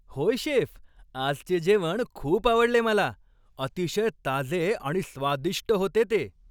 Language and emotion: Marathi, happy